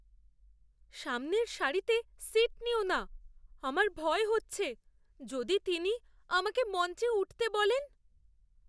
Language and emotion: Bengali, fearful